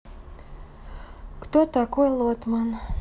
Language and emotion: Russian, sad